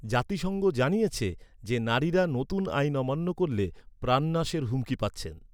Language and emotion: Bengali, neutral